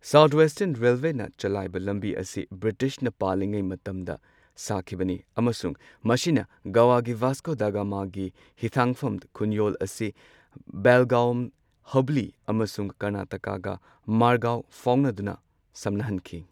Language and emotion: Manipuri, neutral